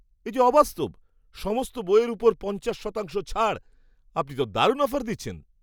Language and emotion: Bengali, surprised